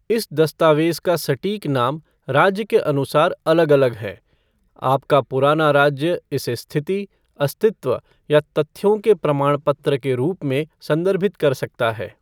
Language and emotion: Hindi, neutral